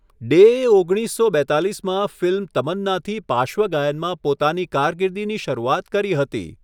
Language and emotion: Gujarati, neutral